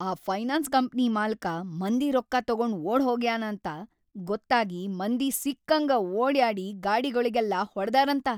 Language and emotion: Kannada, angry